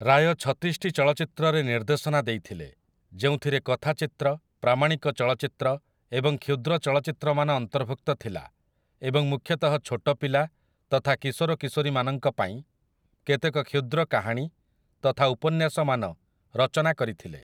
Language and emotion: Odia, neutral